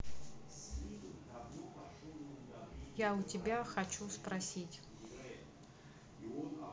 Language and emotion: Russian, neutral